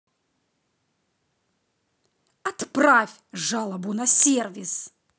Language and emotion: Russian, angry